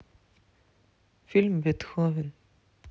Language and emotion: Russian, neutral